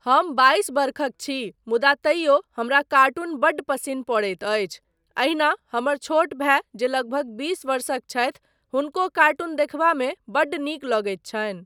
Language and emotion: Maithili, neutral